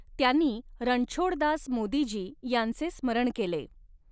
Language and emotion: Marathi, neutral